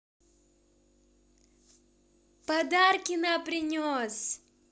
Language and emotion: Russian, positive